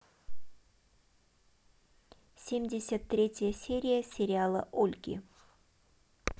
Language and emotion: Russian, neutral